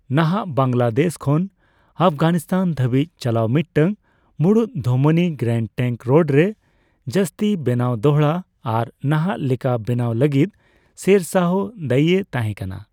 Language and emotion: Santali, neutral